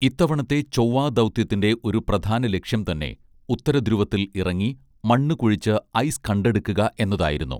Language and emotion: Malayalam, neutral